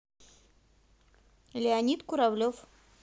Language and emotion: Russian, neutral